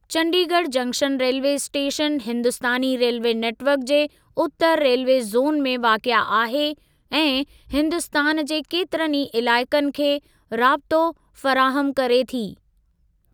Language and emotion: Sindhi, neutral